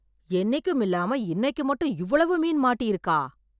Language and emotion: Tamil, surprised